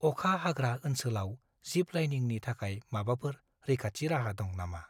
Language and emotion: Bodo, fearful